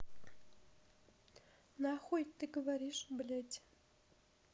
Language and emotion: Russian, neutral